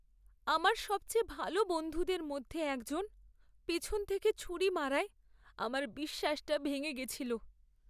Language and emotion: Bengali, sad